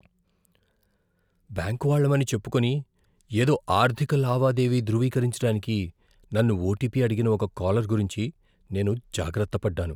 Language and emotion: Telugu, fearful